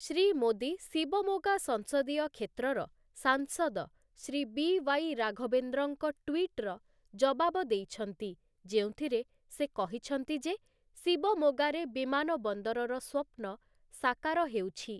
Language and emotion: Odia, neutral